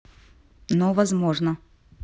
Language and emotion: Russian, neutral